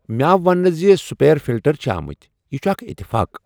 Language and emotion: Kashmiri, surprised